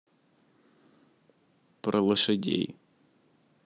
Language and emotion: Russian, neutral